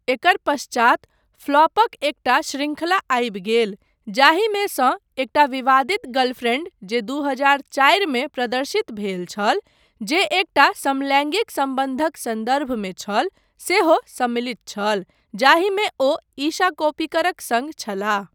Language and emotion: Maithili, neutral